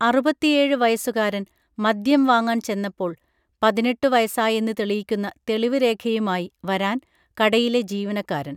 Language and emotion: Malayalam, neutral